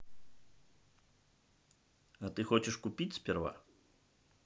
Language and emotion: Russian, neutral